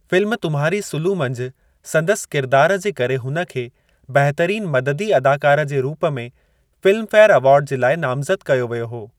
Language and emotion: Sindhi, neutral